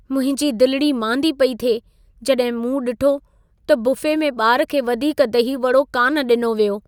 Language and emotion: Sindhi, sad